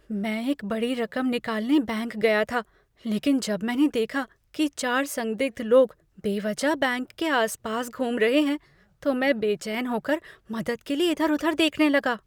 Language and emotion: Hindi, fearful